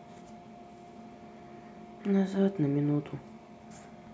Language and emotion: Russian, sad